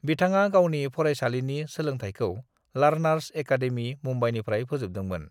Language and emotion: Bodo, neutral